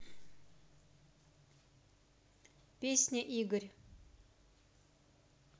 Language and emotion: Russian, neutral